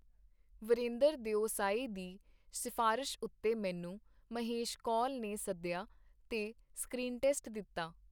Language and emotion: Punjabi, neutral